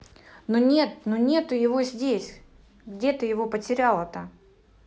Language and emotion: Russian, neutral